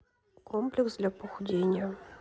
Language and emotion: Russian, neutral